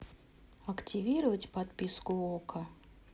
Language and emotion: Russian, neutral